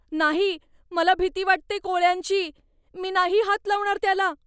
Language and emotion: Marathi, fearful